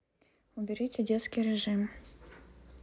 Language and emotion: Russian, neutral